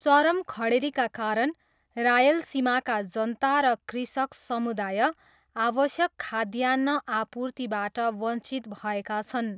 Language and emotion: Nepali, neutral